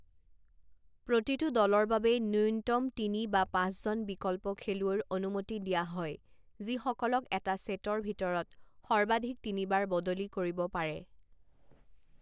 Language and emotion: Assamese, neutral